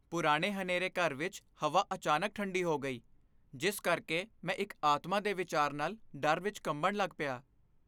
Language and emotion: Punjabi, fearful